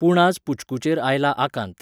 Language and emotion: Goan Konkani, neutral